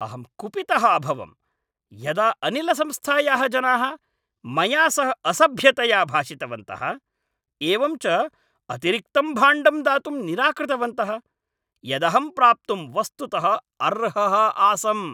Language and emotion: Sanskrit, angry